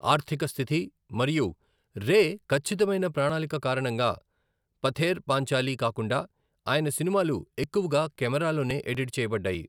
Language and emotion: Telugu, neutral